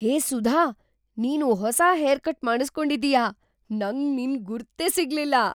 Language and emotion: Kannada, surprised